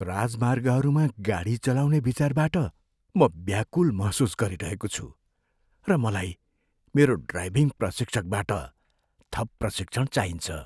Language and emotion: Nepali, fearful